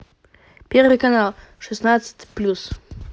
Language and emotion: Russian, positive